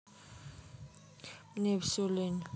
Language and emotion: Russian, neutral